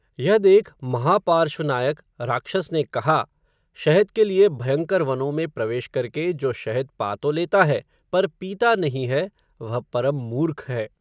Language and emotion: Hindi, neutral